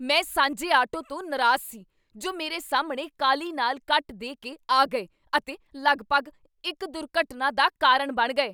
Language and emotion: Punjabi, angry